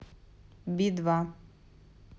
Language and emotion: Russian, neutral